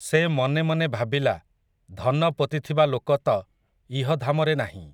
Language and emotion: Odia, neutral